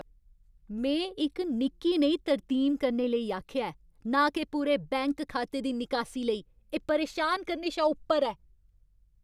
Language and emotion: Dogri, angry